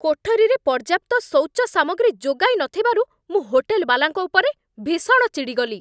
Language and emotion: Odia, angry